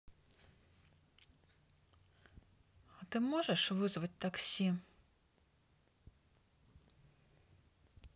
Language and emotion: Russian, neutral